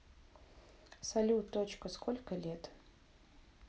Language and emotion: Russian, neutral